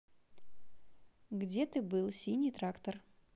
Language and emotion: Russian, neutral